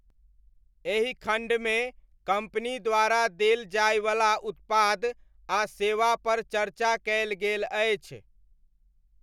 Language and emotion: Maithili, neutral